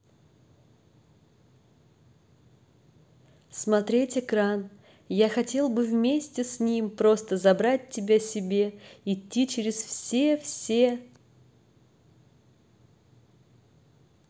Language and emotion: Russian, neutral